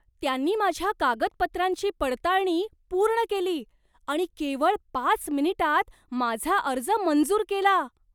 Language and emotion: Marathi, surprised